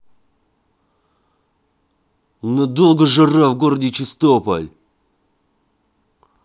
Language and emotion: Russian, angry